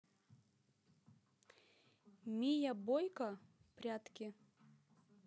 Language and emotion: Russian, neutral